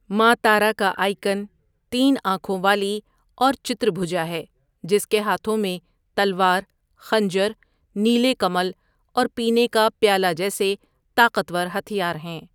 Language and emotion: Urdu, neutral